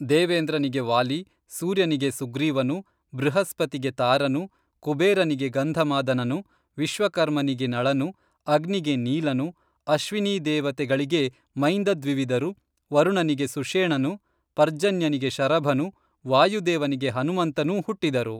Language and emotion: Kannada, neutral